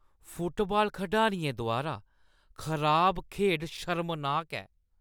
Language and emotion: Dogri, disgusted